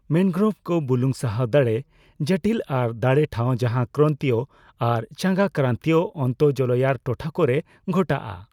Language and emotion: Santali, neutral